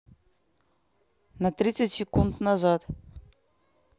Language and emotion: Russian, neutral